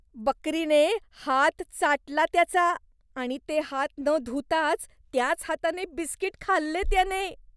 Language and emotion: Marathi, disgusted